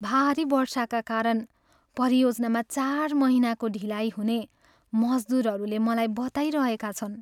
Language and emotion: Nepali, sad